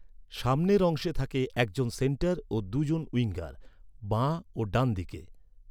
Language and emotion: Bengali, neutral